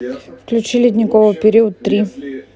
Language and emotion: Russian, neutral